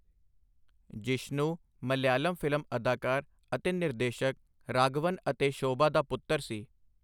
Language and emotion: Punjabi, neutral